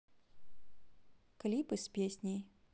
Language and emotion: Russian, neutral